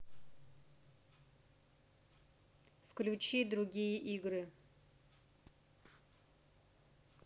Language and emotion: Russian, neutral